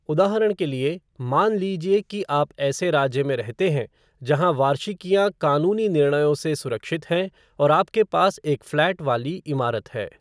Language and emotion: Hindi, neutral